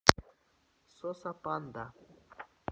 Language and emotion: Russian, neutral